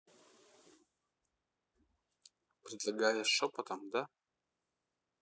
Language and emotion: Russian, neutral